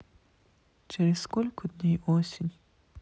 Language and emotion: Russian, sad